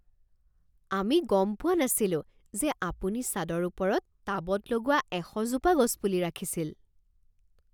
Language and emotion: Assamese, surprised